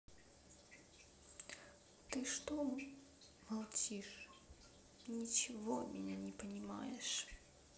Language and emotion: Russian, sad